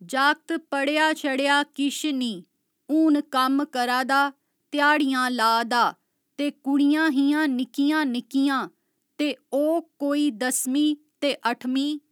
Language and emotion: Dogri, neutral